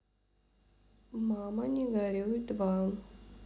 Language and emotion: Russian, neutral